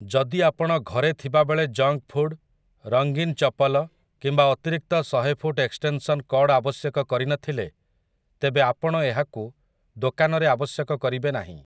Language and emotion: Odia, neutral